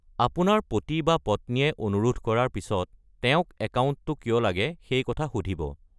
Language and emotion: Assamese, neutral